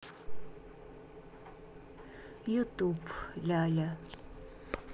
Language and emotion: Russian, neutral